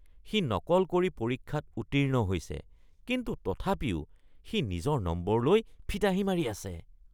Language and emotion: Assamese, disgusted